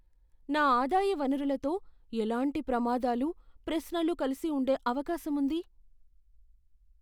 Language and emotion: Telugu, fearful